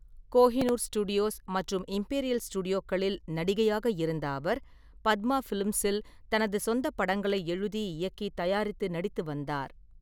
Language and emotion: Tamil, neutral